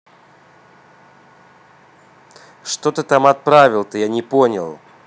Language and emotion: Russian, angry